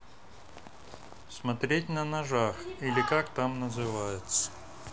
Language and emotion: Russian, neutral